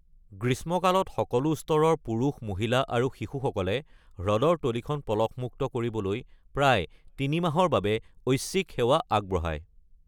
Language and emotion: Assamese, neutral